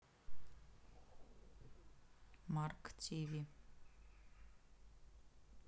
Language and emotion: Russian, neutral